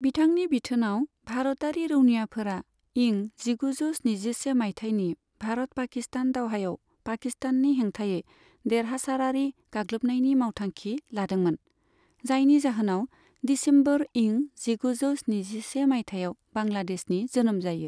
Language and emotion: Bodo, neutral